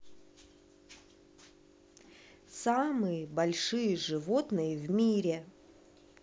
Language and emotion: Russian, neutral